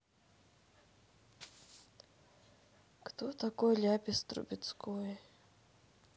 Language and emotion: Russian, sad